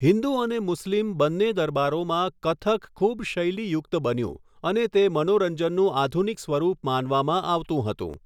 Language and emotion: Gujarati, neutral